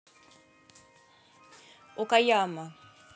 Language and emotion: Russian, neutral